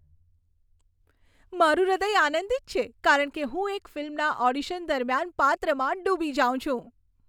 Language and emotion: Gujarati, happy